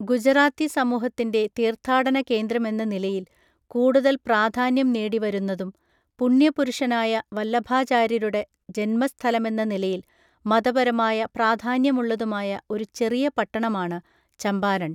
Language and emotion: Malayalam, neutral